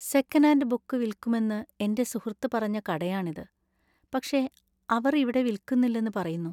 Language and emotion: Malayalam, sad